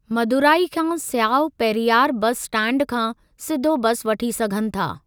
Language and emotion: Sindhi, neutral